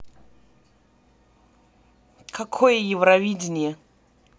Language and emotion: Russian, angry